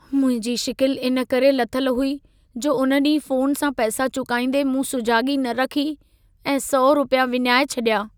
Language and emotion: Sindhi, sad